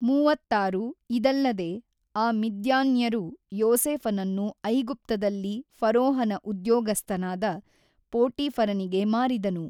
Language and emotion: Kannada, neutral